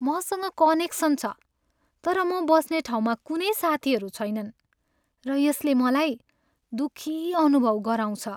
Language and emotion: Nepali, sad